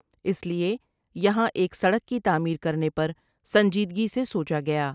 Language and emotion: Urdu, neutral